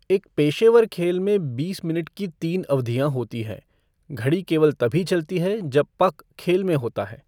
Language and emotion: Hindi, neutral